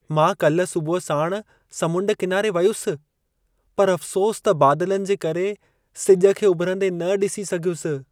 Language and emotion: Sindhi, sad